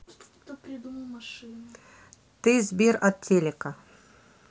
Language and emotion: Russian, neutral